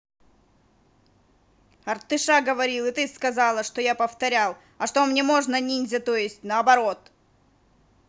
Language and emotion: Russian, angry